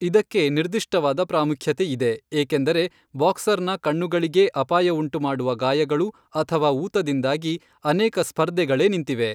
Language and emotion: Kannada, neutral